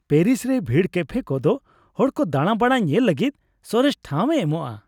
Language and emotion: Santali, happy